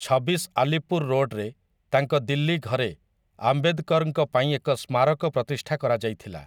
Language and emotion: Odia, neutral